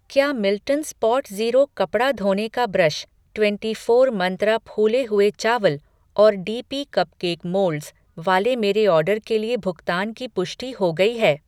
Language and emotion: Hindi, neutral